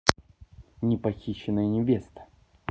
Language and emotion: Russian, neutral